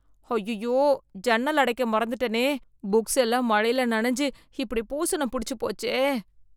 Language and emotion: Tamil, disgusted